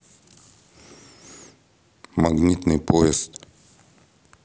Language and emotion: Russian, neutral